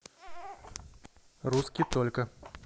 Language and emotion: Russian, neutral